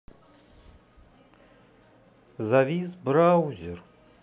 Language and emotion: Russian, sad